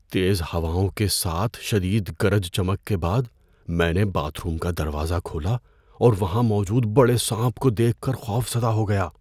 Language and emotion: Urdu, fearful